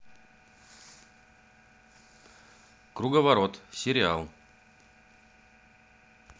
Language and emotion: Russian, neutral